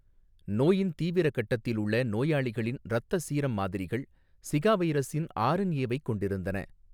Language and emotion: Tamil, neutral